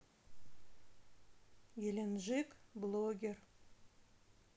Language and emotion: Russian, neutral